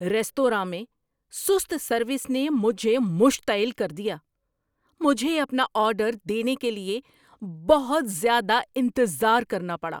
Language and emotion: Urdu, angry